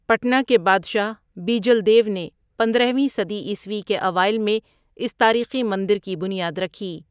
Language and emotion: Urdu, neutral